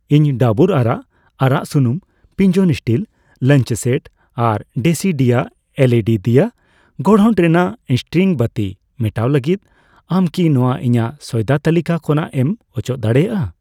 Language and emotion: Santali, neutral